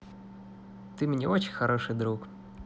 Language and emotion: Russian, positive